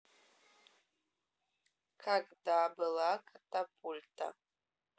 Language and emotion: Russian, neutral